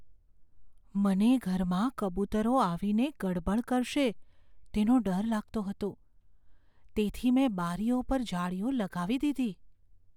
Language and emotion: Gujarati, fearful